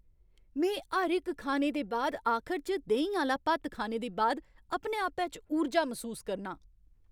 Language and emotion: Dogri, happy